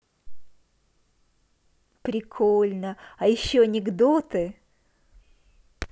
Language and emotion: Russian, positive